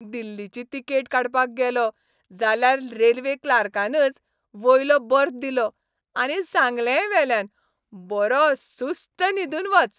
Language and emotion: Goan Konkani, happy